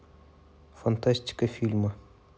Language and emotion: Russian, neutral